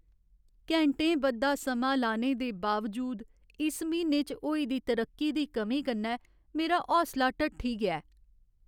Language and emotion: Dogri, sad